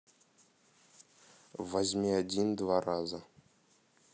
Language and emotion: Russian, neutral